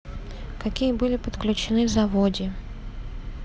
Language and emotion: Russian, neutral